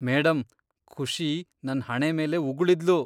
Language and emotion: Kannada, disgusted